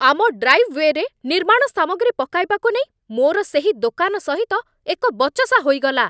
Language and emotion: Odia, angry